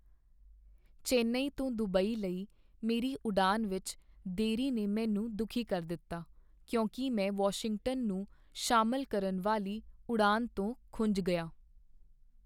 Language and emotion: Punjabi, sad